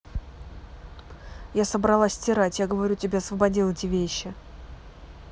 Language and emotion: Russian, angry